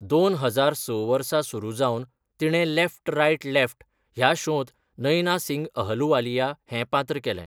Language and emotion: Goan Konkani, neutral